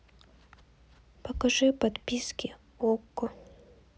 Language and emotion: Russian, neutral